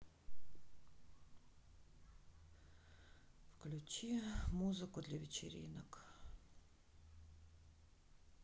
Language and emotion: Russian, sad